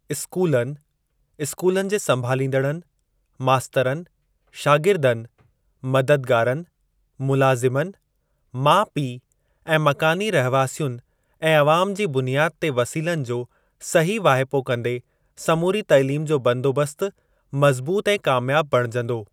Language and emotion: Sindhi, neutral